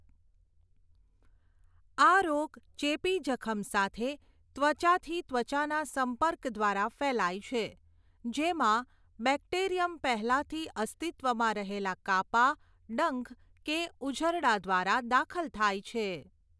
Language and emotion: Gujarati, neutral